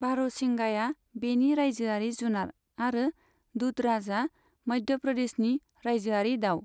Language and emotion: Bodo, neutral